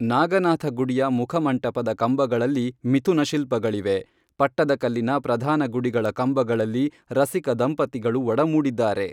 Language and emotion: Kannada, neutral